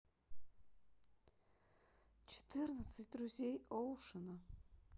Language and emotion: Russian, sad